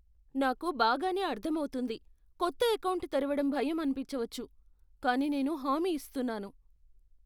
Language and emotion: Telugu, fearful